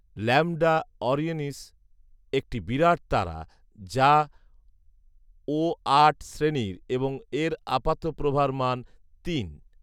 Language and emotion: Bengali, neutral